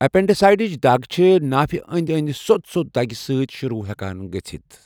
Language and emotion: Kashmiri, neutral